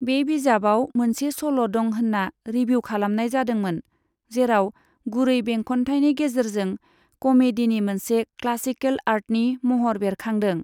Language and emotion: Bodo, neutral